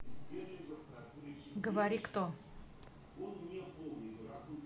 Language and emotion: Russian, neutral